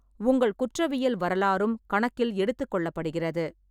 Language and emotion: Tamil, neutral